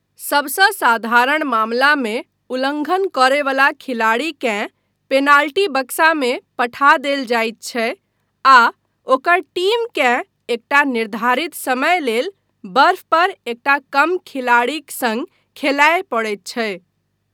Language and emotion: Maithili, neutral